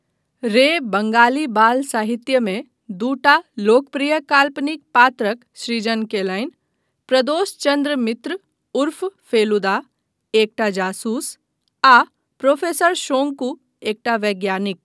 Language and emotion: Maithili, neutral